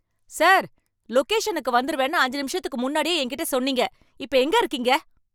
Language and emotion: Tamil, angry